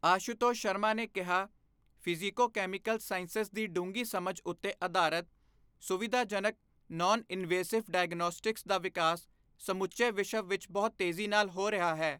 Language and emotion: Punjabi, neutral